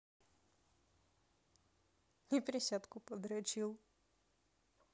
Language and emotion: Russian, neutral